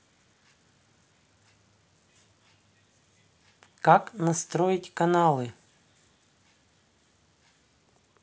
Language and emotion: Russian, neutral